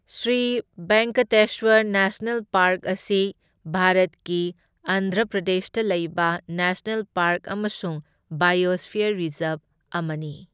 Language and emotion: Manipuri, neutral